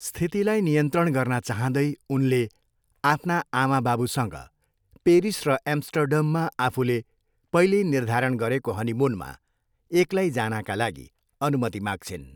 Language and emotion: Nepali, neutral